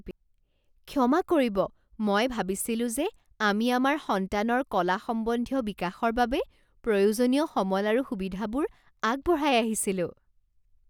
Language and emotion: Assamese, surprised